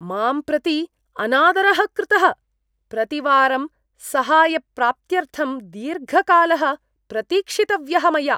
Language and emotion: Sanskrit, disgusted